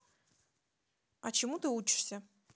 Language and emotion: Russian, neutral